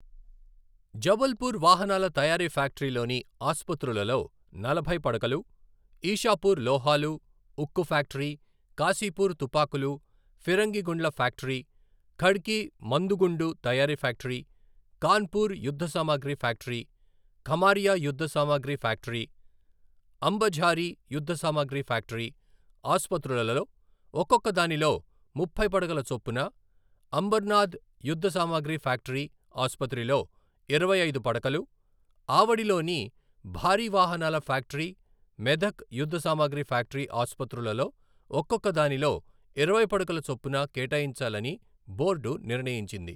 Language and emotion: Telugu, neutral